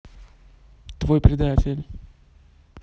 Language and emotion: Russian, neutral